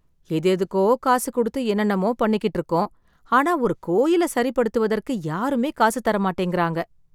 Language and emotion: Tamil, sad